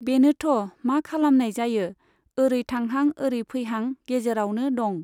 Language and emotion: Bodo, neutral